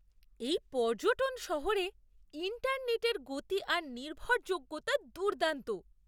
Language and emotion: Bengali, surprised